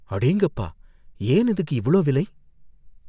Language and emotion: Tamil, fearful